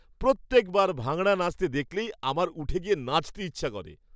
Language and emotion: Bengali, happy